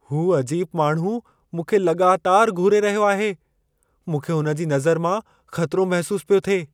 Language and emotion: Sindhi, fearful